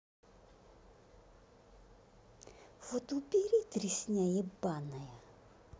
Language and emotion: Russian, angry